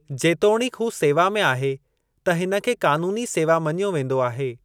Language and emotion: Sindhi, neutral